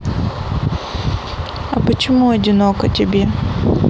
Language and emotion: Russian, sad